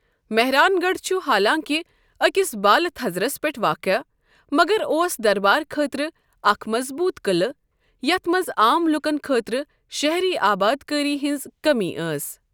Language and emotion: Kashmiri, neutral